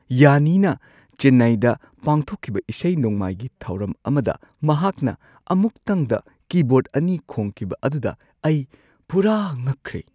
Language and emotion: Manipuri, surprised